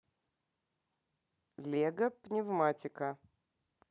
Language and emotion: Russian, neutral